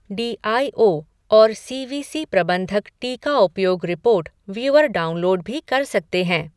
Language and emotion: Hindi, neutral